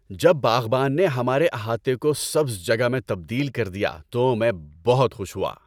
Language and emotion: Urdu, happy